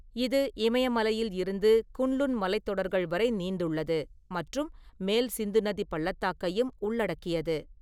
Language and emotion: Tamil, neutral